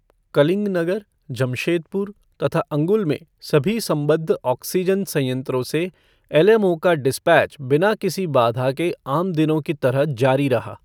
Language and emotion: Hindi, neutral